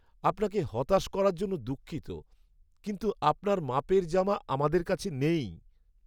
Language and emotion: Bengali, sad